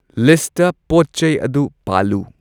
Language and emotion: Manipuri, neutral